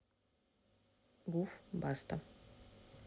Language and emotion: Russian, neutral